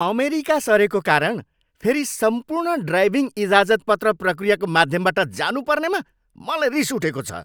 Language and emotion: Nepali, angry